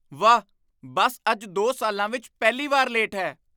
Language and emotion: Punjabi, surprised